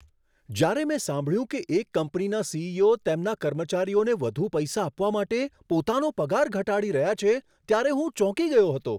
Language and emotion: Gujarati, surprised